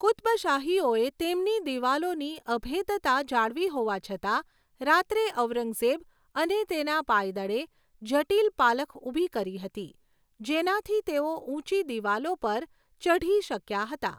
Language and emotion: Gujarati, neutral